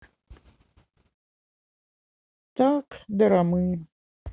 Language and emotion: Russian, sad